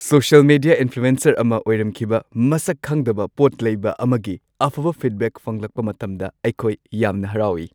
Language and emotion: Manipuri, happy